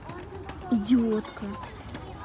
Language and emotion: Russian, angry